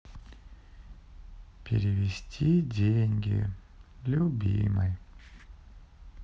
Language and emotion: Russian, sad